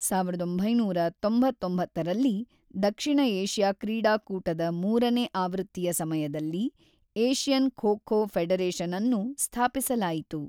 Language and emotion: Kannada, neutral